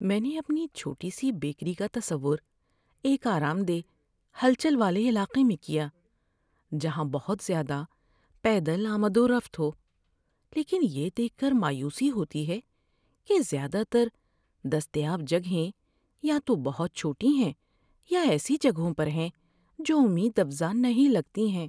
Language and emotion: Urdu, sad